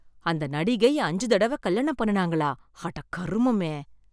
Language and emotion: Tamil, disgusted